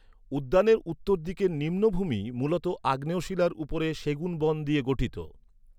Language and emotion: Bengali, neutral